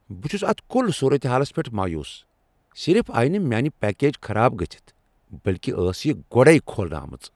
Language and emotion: Kashmiri, angry